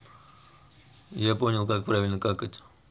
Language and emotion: Russian, neutral